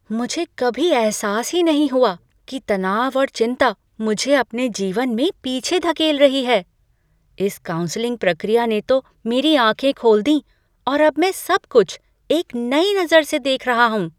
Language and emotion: Hindi, surprised